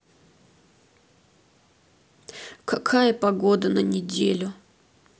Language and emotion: Russian, sad